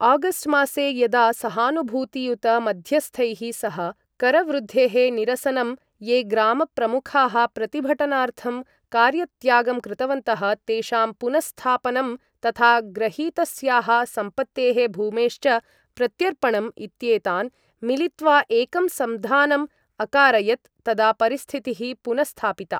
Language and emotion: Sanskrit, neutral